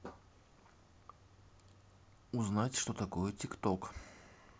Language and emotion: Russian, neutral